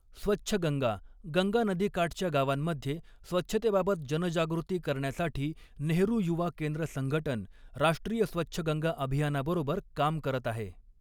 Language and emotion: Marathi, neutral